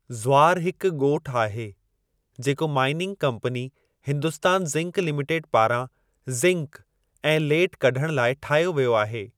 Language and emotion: Sindhi, neutral